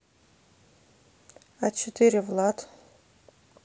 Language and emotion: Russian, neutral